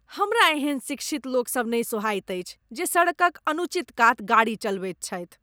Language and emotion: Maithili, disgusted